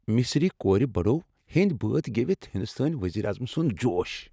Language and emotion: Kashmiri, happy